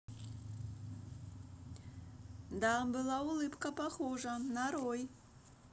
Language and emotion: Russian, positive